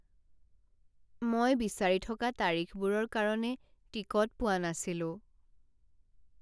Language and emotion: Assamese, sad